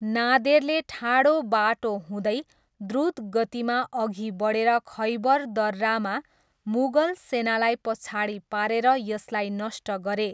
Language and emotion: Nepali, neutral